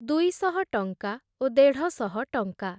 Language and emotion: Odia, neutral